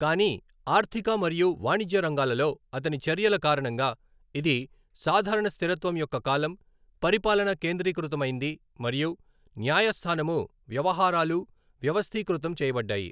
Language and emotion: Telugu, neutral